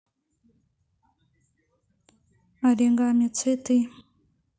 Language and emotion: Russian, neutral